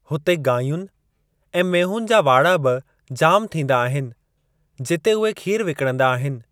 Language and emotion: Sindhi, neutral